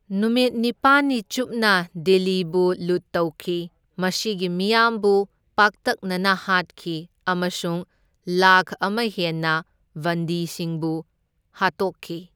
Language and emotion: Manipuri, neutral